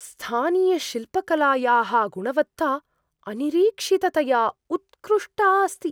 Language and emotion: Sanskrit, surprised